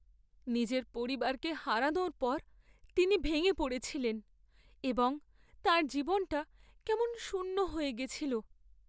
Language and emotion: Bengali, sad